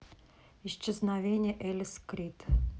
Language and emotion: Russian, neutral